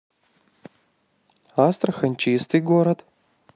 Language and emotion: Russian, positive